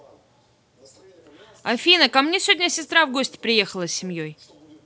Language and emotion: Russian, neutral